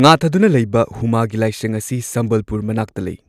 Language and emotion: Manipuri, neutral